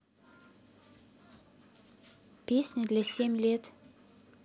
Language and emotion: Russian, neutral